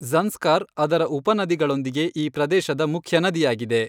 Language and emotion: Kannada, neutral